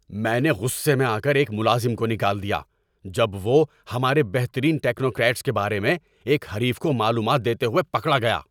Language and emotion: Urdu, angry